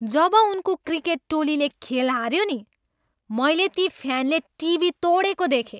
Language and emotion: Nepali, angry